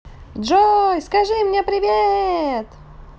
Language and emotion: Russian, positive